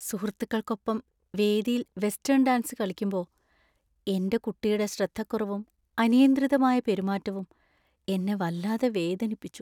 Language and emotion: Malayalam, sad